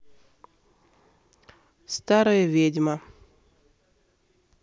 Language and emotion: Russian, neutral